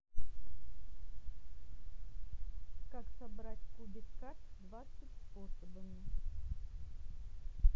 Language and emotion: Russian, neutral